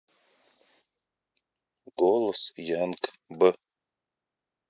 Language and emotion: Russian, neutral